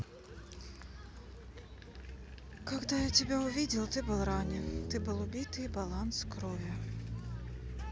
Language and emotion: Russian, sad